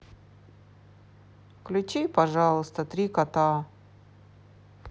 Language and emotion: Russian, sad